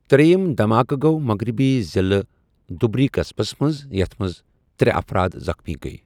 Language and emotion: Kashmiri, neutral